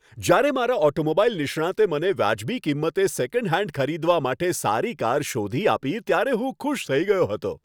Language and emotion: Gujarati, happy